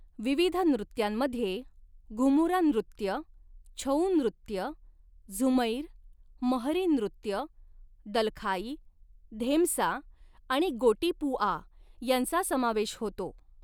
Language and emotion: Marathi, neutral